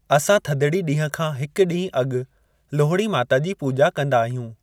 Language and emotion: Sindhi, neutral